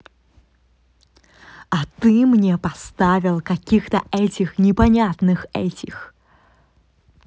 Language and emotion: Russian, angry